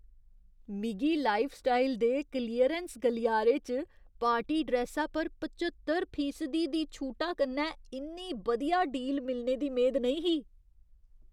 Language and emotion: Dogri, surprised